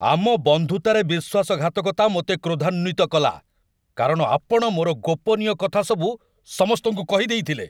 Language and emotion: Odia, angry